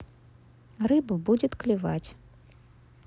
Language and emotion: Russian, neutral